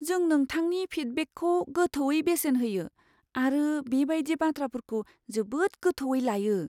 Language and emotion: Bodo, fearful